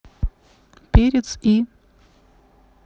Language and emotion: Russian, neutral